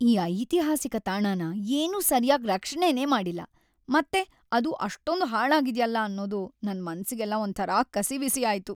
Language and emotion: Kannada, sad